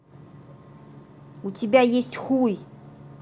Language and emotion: Russian, angry